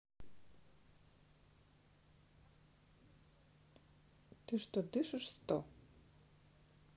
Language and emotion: Russian, neutral